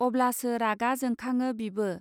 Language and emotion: Bodo, neutral